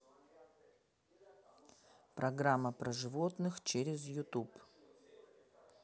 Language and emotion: Russian, neutral